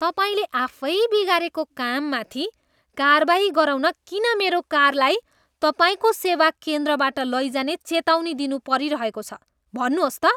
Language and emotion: Nepali, disgusted